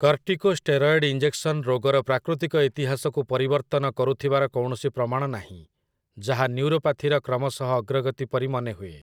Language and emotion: Odia, neutral